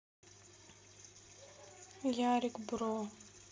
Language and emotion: Russian, sad